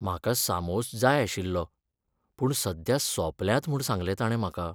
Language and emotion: Goan Konkani, sad